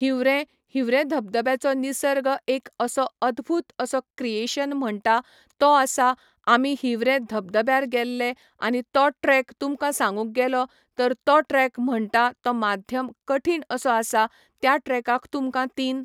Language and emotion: Goan Konkani, neutral